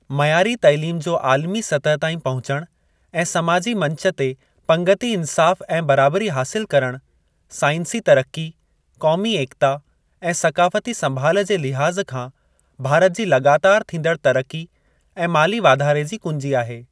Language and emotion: Sindhi, neutral